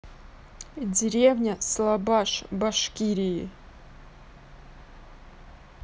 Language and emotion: Russian, neutral